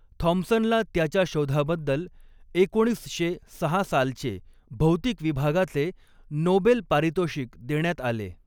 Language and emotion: Marathi, neutral